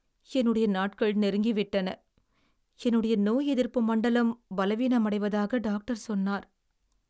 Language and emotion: Tamil, sad